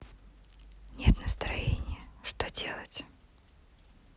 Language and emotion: Russian, sad